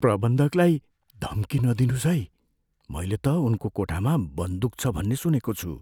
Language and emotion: Nepali, fearful